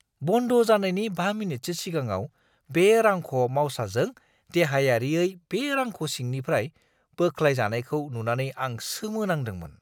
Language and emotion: Bodo, surprised